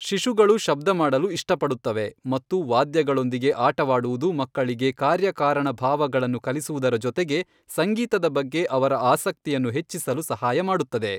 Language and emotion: Kannada, neutral